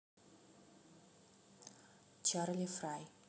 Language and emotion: Russian, neutral